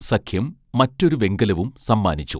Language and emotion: Malayalam, neutral